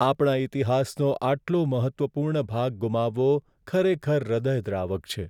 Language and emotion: Gujarati, sad